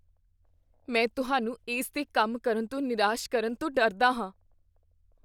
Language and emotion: Punjabi, fearful